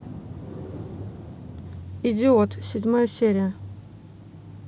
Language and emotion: Russian, neutral